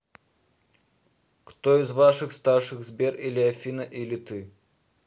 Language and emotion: Russian, neutral